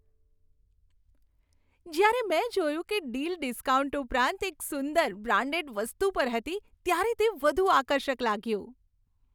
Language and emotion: Gujarati, happy